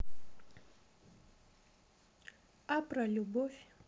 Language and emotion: Russian, neutral